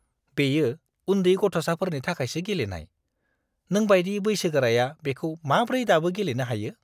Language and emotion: Bodo, disgusted